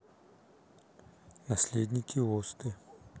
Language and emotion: Russian, neutral